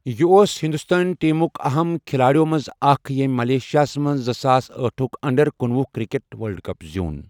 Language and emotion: Kashmiri, neutral